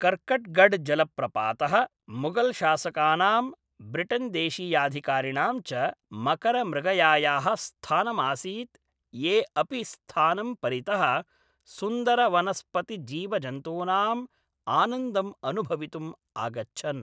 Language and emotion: Sanskrit, neutral